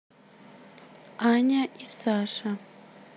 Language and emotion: Russian, neutral